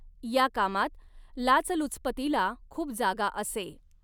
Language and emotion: Marathi, neutral